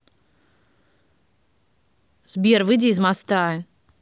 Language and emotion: Russian, angry